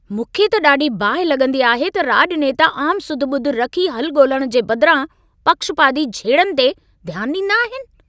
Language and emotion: Sindhi, angry